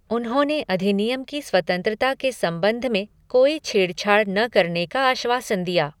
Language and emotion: Hindi, neutral